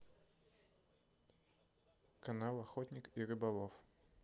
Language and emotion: Russian, neutral